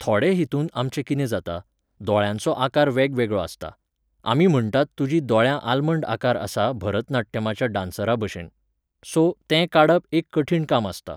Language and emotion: Goan Konkani, neutral